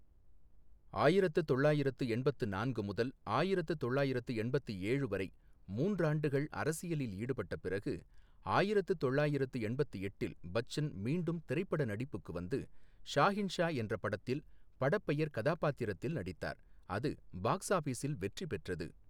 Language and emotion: Tamil, neutral